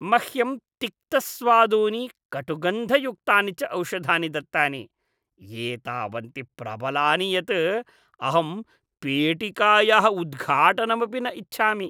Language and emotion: Sanskrit, disgusted